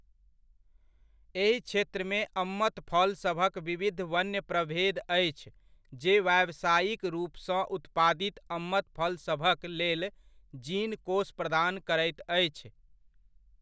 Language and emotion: Maithili, neutral